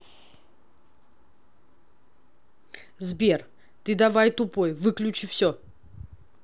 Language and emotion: Russian, neutral